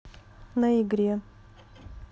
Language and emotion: Russian, neutral